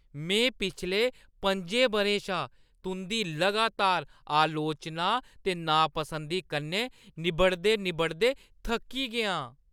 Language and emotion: Dogri, disgusted